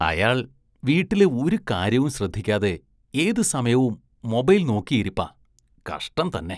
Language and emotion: Malayalam, disgusted